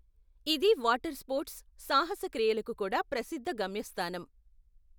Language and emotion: Telugu, neutral